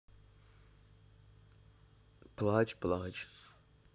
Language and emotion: Russian, sad